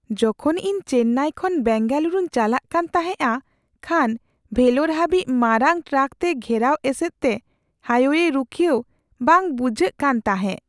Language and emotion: Santali, fearful